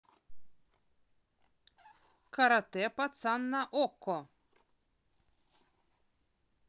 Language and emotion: Russian, positive